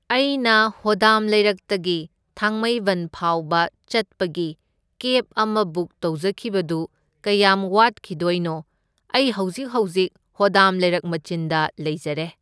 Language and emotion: Manipuri, neutral